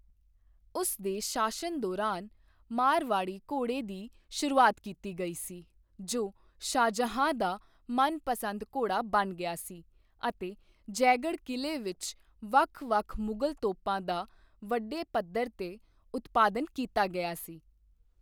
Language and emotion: Punjabi, neutral